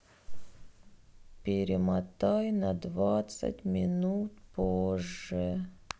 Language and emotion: Russian, sad